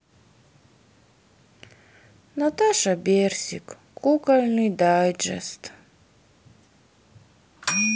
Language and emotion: Russian, sad